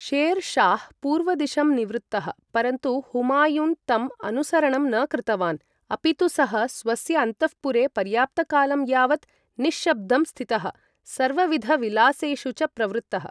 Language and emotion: Sanskrit, neutral